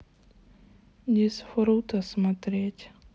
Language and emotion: Russian, sad